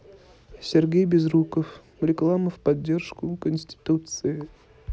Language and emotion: Russian, neutral